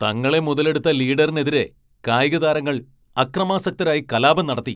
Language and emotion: Malayalam, angry